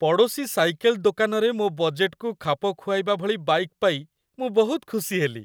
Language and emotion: Odia, happy